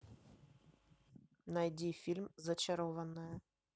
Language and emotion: Russian, neutral